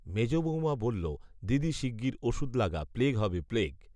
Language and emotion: Bengali, neutral